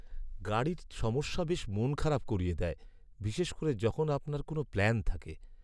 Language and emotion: Bengali, sad